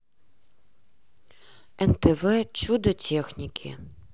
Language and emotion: Russian, neutral